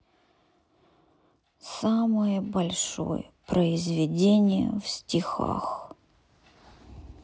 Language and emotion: Russian, sad